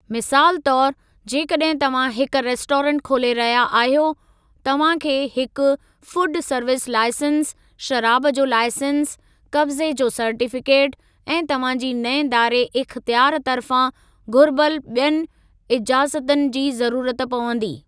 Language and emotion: Sindhi, neutral